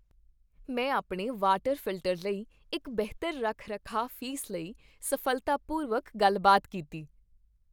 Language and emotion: Punjabi, happy